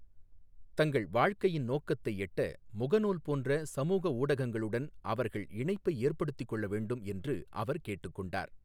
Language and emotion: Tamil, neutral